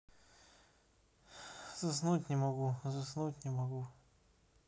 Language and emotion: Russian, sad